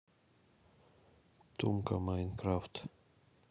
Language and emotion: Russian, neutral